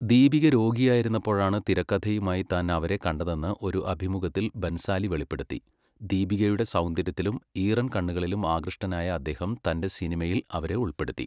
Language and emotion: Malayalam, neutral